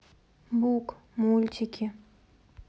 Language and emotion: Russian, sad